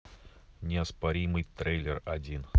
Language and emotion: Russian, neutral